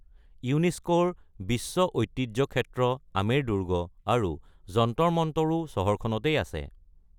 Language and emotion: Assamese, neutral